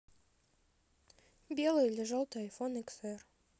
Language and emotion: Russian, neutral